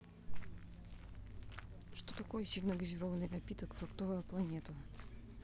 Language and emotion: Russian, neutral